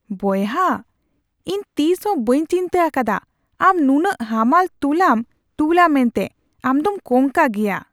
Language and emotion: Santali, surprised